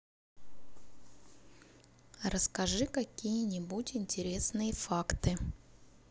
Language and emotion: Russian, neutral